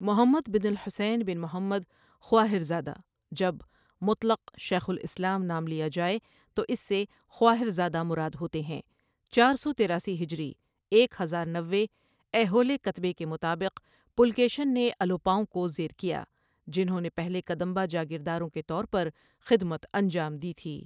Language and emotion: Urdu, neutral